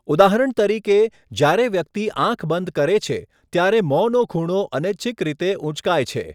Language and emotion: Gujarati, neutral